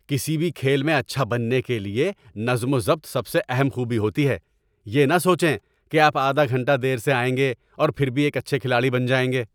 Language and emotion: Urdu, angry